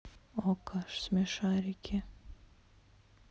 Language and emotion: Russian, neutral